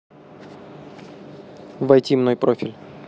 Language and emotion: Russian, neutral